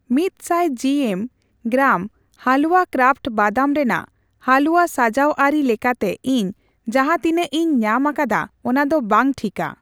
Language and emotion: Santali, neutral